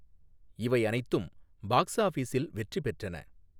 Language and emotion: Tamil, neutral